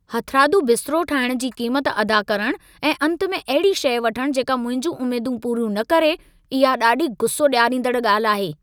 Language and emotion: Sindhi, angry